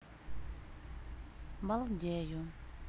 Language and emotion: Russian, neutral